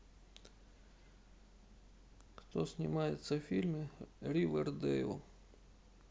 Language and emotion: Russian, sad